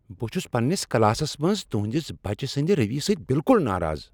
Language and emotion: Kashmiri, angry